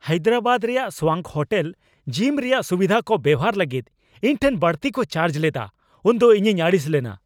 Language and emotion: Santali, angry